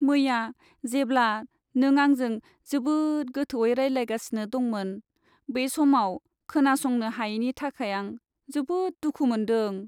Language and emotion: Bodo, sad